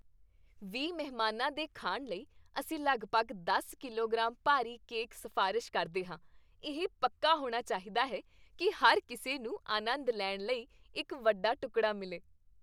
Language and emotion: Punjabi, happy